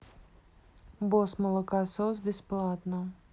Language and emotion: Russian, neutral